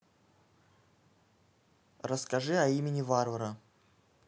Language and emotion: Russian, neutral